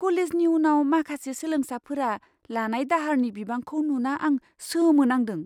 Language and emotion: Bodo, surprised